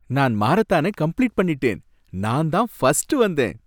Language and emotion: Tamil, happy